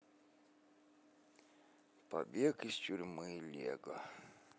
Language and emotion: Russian, sad